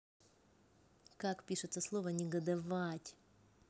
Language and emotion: Russian, angry